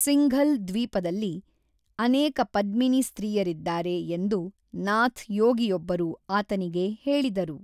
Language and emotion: Kannada, neutral